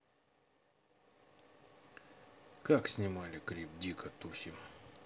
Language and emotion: Russian, neutral